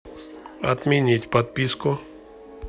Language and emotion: Russian, neutral